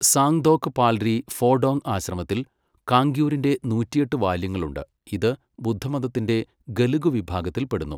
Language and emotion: Malayalam, neutral